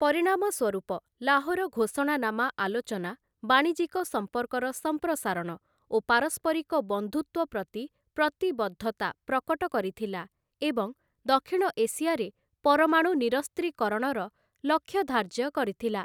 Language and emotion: Odia, neutral